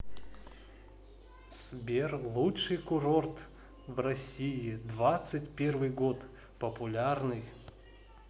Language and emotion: Russian, positive